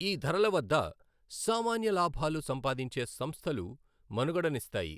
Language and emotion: Telugu, neutral